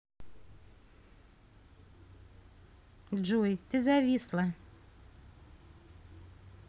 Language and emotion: Russian, neutral